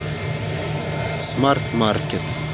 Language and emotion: Russian, neutral